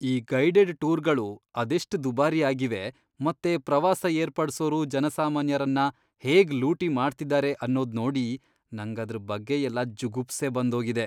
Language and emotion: Kannada, disgusted